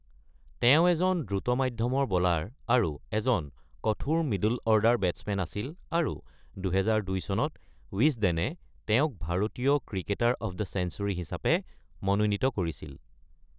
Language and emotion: Assamese, neutral